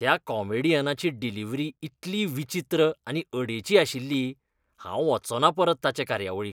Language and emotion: Goan Konkani, disgusted